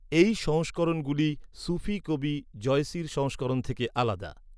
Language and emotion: Bengali, neutral